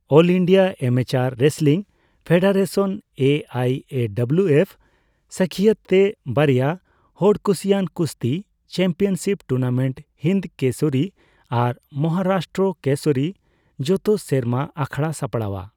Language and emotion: Santali, neutral